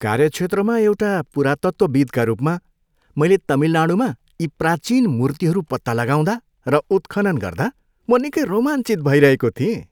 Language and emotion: Nepali, happy